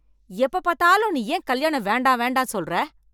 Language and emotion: Tamil, angry